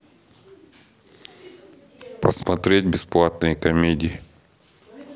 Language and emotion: Russian, neutral